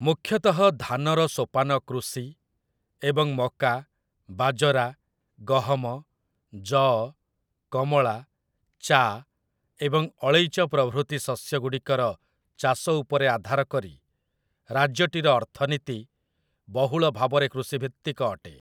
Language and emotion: Odia, neutral